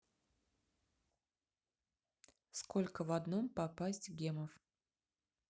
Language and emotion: Russian, neutral